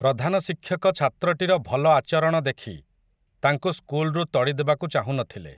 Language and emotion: Odia, neutral